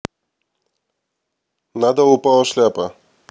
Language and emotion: Russian, neutral